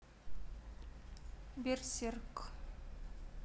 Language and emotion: Russian, neutral